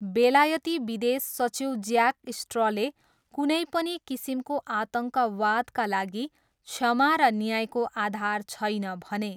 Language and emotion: Nepali, neutral